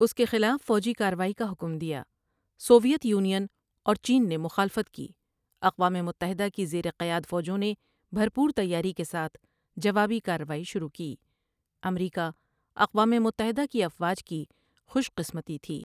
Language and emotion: Urdu, neutral